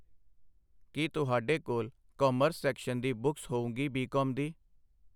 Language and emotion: Punjabi, neutral